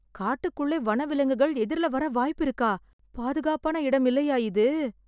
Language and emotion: Tamil, fearful